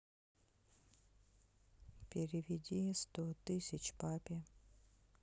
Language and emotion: Russian, sad